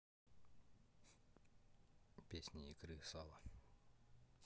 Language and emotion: Russian, neutral